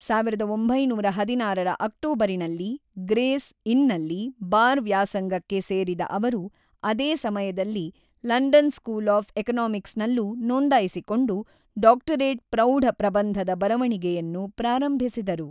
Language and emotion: Kannada, neutral